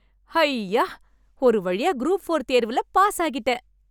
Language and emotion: Tamil, happy